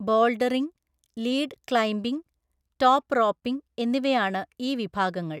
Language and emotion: Malayalam, neutral